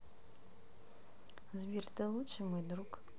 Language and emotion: Russian, neutral